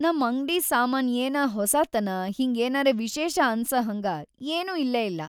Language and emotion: Kannada, sad